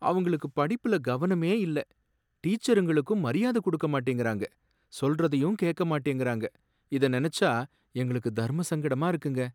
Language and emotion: Tamil, sad